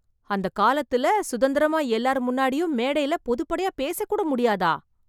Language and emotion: Tamil, surprised